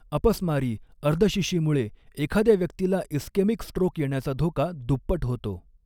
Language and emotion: Marathi, neutral